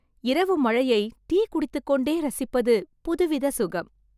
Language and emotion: Tamil, happy